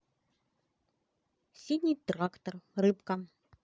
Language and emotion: Russian, positive